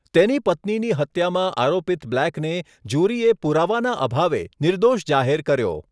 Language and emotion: Gujarati, neutral